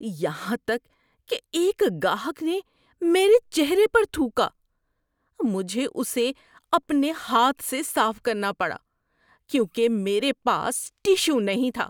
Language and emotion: Urdu, disgusted